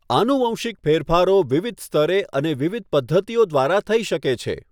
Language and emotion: Gujarati, neutral